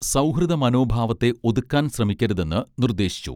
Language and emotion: Malayalam, neutral